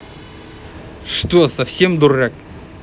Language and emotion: Russian, angry